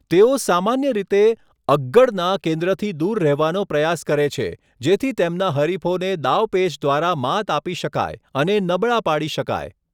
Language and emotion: Gujarati, neutral